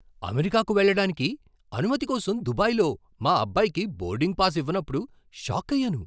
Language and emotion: Telugu, surprised